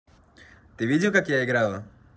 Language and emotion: Russian, positive